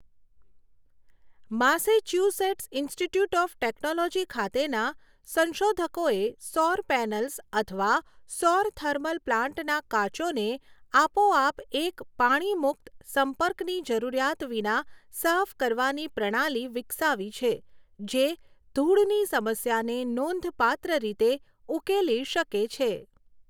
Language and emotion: Gujarati, neutral